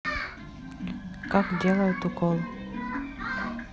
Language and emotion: Russian, neutral